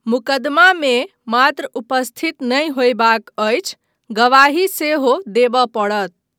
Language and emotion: Maithili, neutral